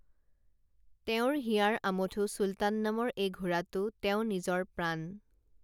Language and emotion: Assamese, neutral